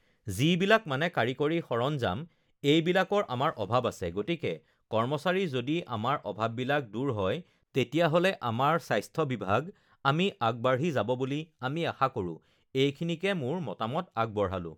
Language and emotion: Assamese, neutral